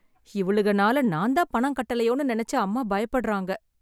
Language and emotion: Tamil, sad